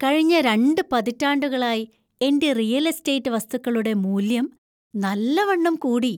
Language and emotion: Malayalam, happy